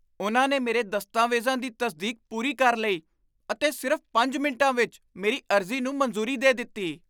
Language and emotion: Punjabi, surprised